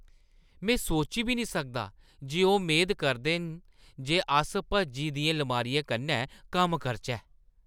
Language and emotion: Dogri, disgusted